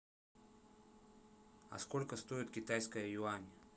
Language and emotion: Russian, neutral